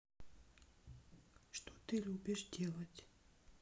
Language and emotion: Russian, neutral